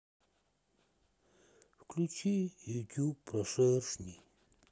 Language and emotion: Russian, sad